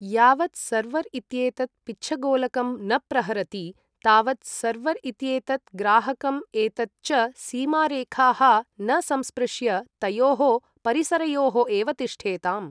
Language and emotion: Sanskrit, neutral